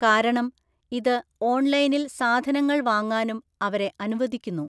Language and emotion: Malayalam, neutral